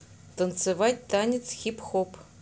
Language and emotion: Russian, neutral